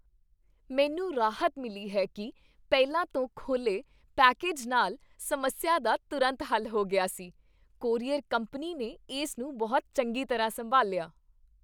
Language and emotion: Punjabi, happy